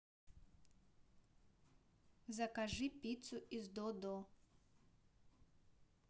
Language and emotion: Russian, neutral